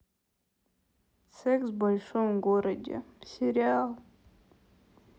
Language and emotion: Russian, sad